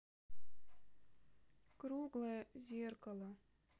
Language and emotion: Russian, sad